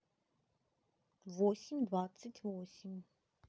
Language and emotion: Russian, neutral